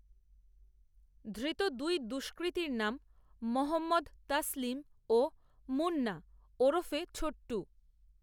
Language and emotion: Bengali, neutral